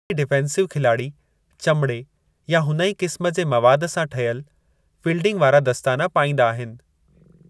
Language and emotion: Sindhi, neutral